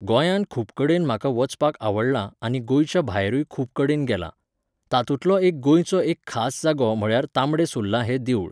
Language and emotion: Goan Konkani, neutral